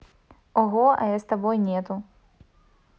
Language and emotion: Russian, positive